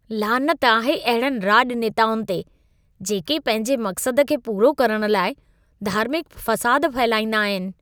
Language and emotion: Sindhi, disgusted